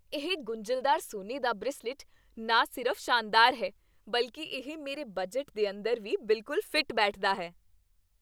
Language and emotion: Punjabi, happy